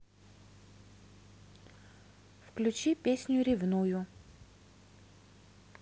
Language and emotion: Russian, neutral